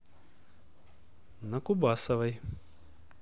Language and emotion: Russian, neutral